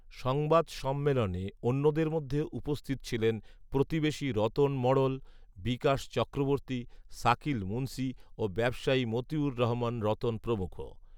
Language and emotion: Bengali, neutral